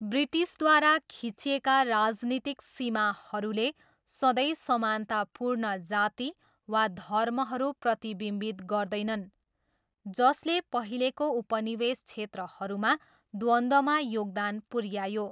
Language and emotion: Nepali, neutral